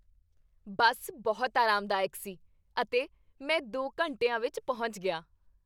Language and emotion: Punjabi, happy